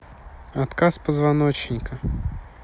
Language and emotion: Russian, neutral